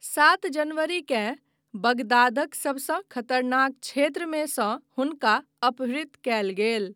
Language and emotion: Maithili, neutral